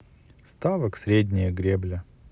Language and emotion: Russian, sad